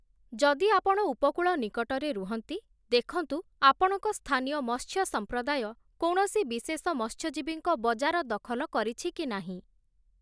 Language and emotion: Odia, neutral